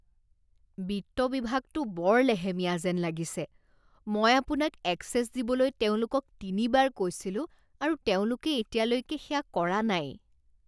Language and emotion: Assamese, disgusted